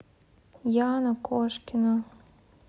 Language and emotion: Russian, sad